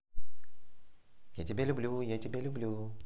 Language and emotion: Russian, positive